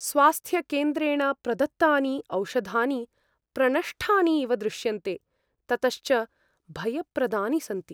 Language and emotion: Sanskrit, fearful